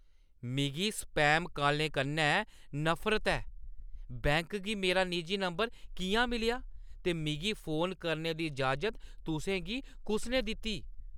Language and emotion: Dogri, angry